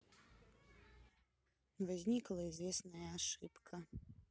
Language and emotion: Russian, sad